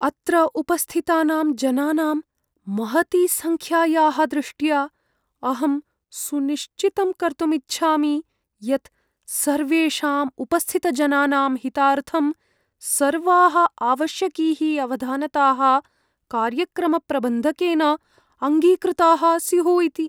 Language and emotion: Sanskrit, fearful